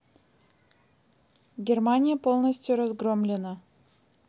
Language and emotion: Russian, neutral